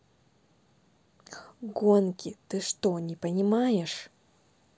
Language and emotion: Russian, angry